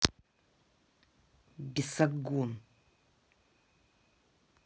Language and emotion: Russian, angry